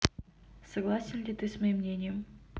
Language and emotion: Russian, neutral